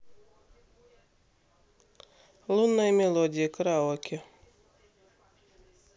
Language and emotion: Russian, neutral